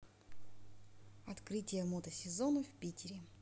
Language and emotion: Russian, neutral